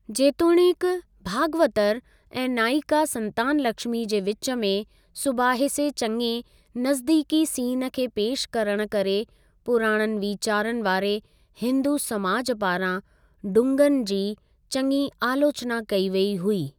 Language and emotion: Sindhi, neutral